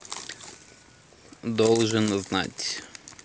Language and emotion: Russian, neutral